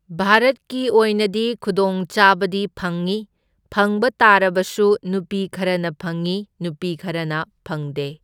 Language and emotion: Manipuri, neutral